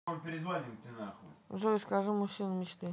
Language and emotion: Russian, neutral